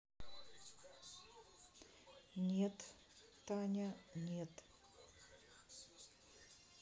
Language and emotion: Russian, neutral